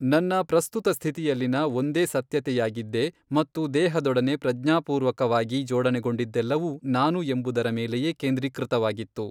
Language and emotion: Kannada, neutral